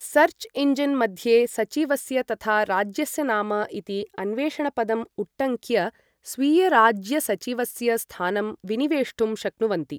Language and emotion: Sanskrit, neutral